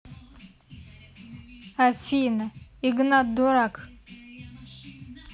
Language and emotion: Russian, neutral